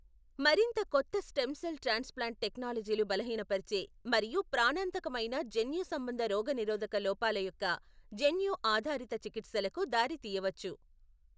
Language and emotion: Telugu, neutral